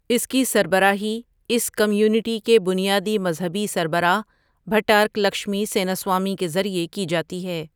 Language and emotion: Urdu, neutral